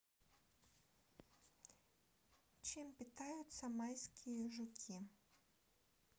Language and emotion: Russian, neutral